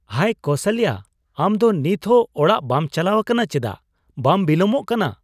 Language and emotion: Santali, surprised